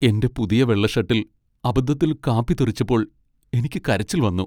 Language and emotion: Malayalam, sad